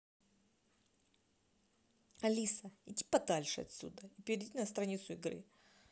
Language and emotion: Russian, angry